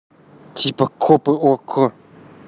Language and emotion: Russian, neutral